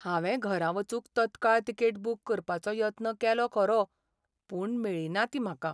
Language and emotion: Goan Konkani, sad